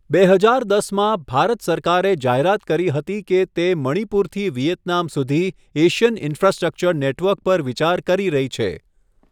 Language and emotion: Gujarati, neutral